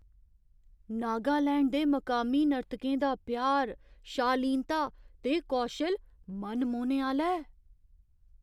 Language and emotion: Dogri, surprised